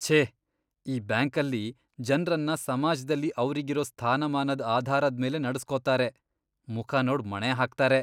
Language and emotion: Kannada, disgusted